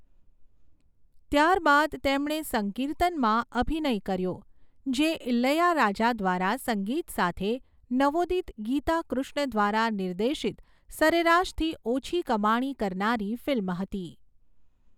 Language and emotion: Gujarati, neutral